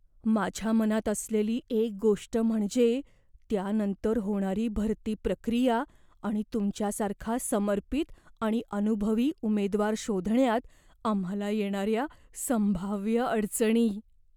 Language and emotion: Marathi, fearful